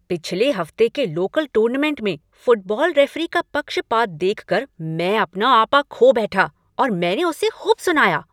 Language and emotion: Hindi, angry